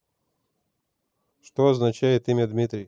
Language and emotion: Russian, neutral